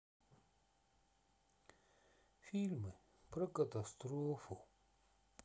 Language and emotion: Russian, sad